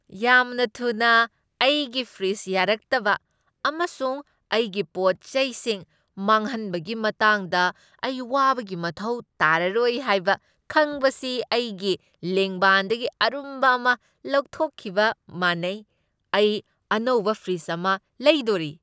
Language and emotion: Manipuri, happy